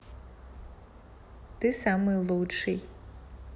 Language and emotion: Russian, positive